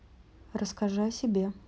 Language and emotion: Russian, neutral